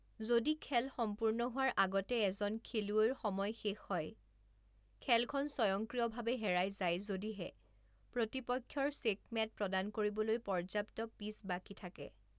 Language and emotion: Assamese, neutral